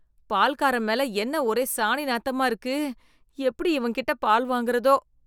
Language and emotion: Tamil, disgusted